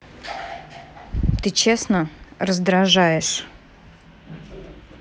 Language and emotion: Russian, angry